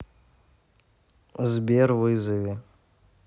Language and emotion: Russian, neutral